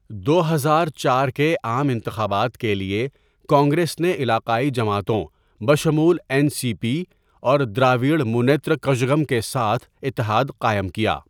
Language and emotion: Urdu, neutral